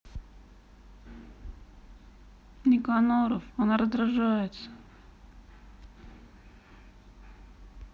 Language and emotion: Russian, sad